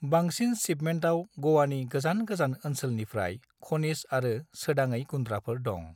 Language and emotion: Bodo, neutral